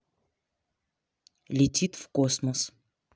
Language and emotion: Russian, neutral